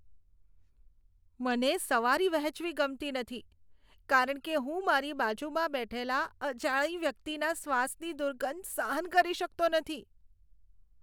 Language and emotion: Gujarati, disgusted